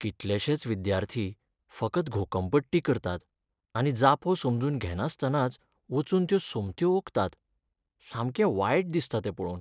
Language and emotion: Goan Konkani, sad